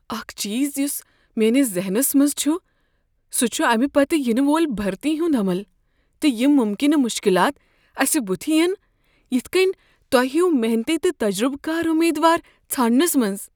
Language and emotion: Kashmiri, fearful